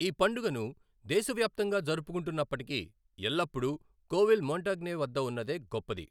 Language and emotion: Telugu, neutral